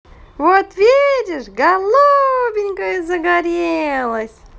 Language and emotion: Russian, positive